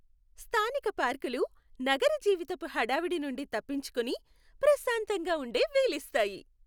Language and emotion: Telugu, happy